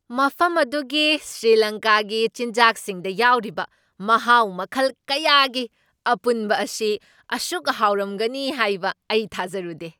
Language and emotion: Manipuri, surprised